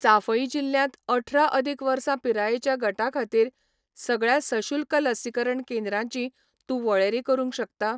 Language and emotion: Goan Konkani, neutral